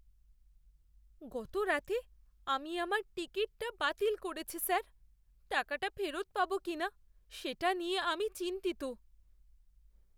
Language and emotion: Bengali, fearful